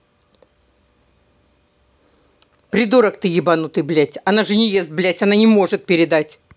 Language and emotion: Russian, angry